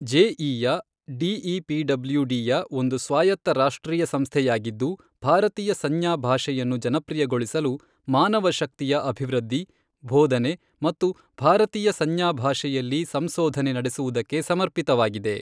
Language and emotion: Kannada, neutral